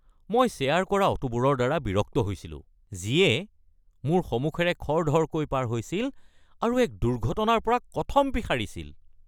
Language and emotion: Assamese, angry